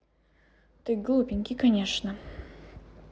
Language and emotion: Russian, neutral